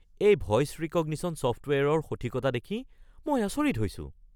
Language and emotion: Assamese, surprised